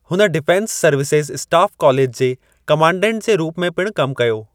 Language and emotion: Sindhi, neutral